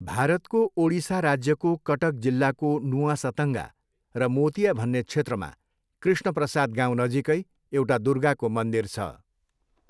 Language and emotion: Nepali, neutral